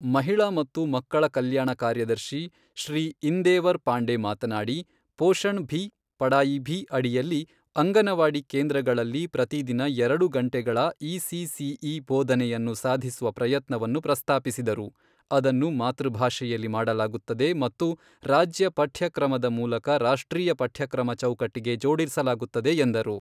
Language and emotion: Kannada, neutral